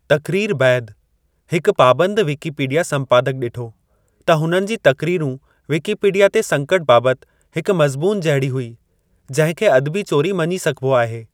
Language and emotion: Sindhi, neutral